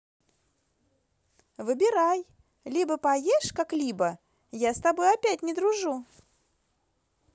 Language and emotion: Russian, positive